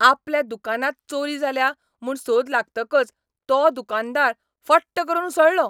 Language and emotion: Goan Konkani, angry